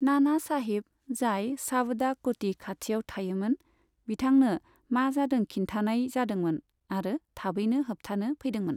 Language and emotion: Bodo, neutral